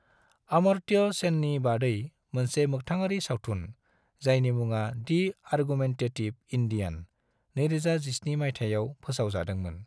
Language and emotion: Bodo, neutral